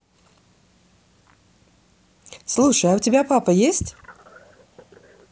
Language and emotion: Russian, positive